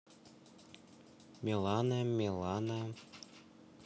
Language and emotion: Russian, neutral